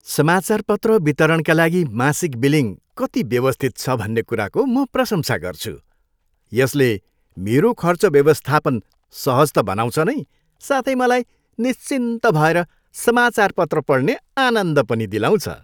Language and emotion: Nepali, happy